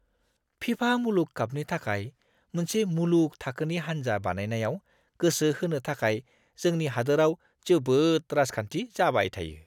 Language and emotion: Bodo, disgusted